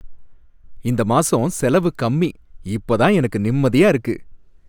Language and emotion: Tamil, happy